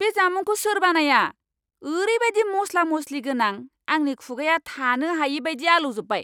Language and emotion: Bodo, angry